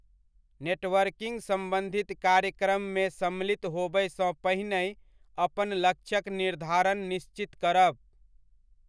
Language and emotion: Maithili, neutral